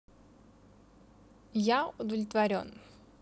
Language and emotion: Russian, positive